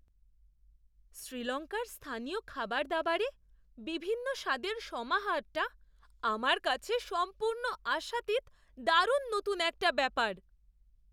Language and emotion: Bengali, surprised